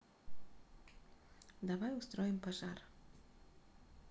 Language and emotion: Russian, neutral